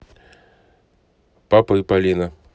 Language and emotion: Russian, neutral